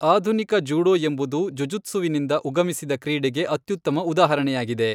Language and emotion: Kannada, neutral